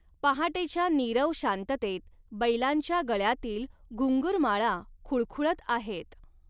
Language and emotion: Marathi, neutral